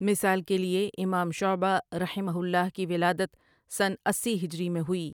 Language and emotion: Urdu, neutral